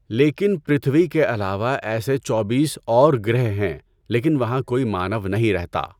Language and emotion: Urdu, neutral